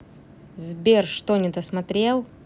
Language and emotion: Russian, angry